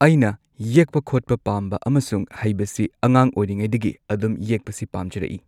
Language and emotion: Manipuri, neutral